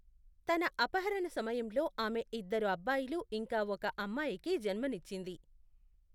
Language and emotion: Telugu, neutral